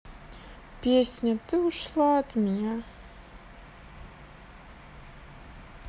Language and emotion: Russian, neutral